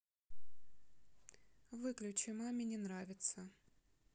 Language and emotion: Russian, sad